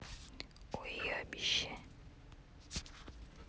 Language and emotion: Russian, neutral